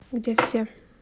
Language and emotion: Russian, neutral